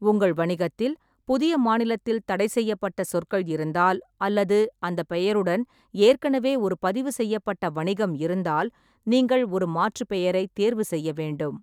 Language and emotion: Tamil, neutral